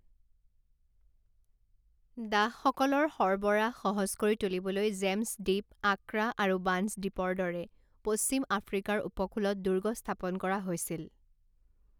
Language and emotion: Assamese, neutral